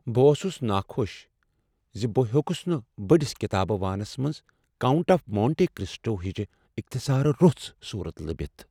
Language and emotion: Kashmiri, sad